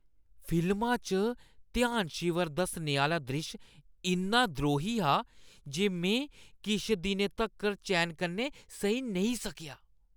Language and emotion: Dogri, disgusted